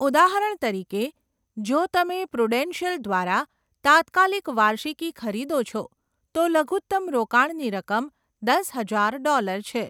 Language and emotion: Gujarati, neutral